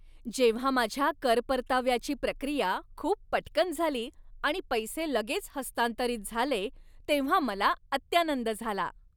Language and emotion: Marathi, happy